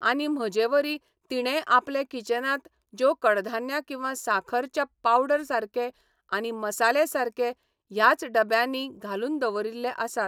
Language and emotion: Goan Konkani, neutral